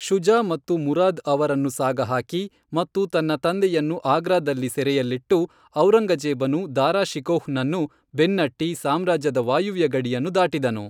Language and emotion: Kannada, neutral